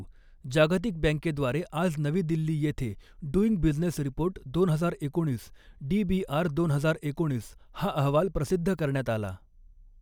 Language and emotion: Marathi, neutral